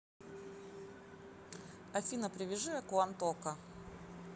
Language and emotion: Russian, neutral